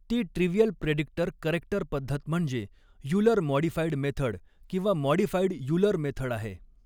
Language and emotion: Marathi, neutral